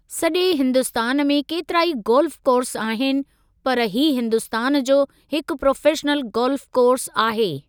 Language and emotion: Sindhi, neutral